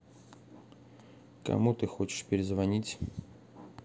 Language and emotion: Russian, neutral